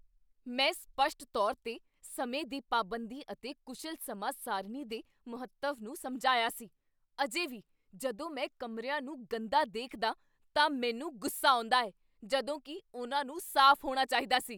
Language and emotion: Punjabi, angry